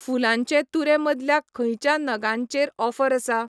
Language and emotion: Goan Konkani, neutral